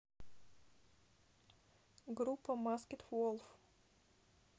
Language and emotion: Russian, neutral